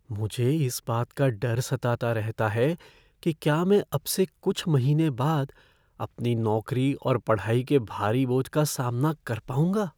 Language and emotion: Hindi, fearful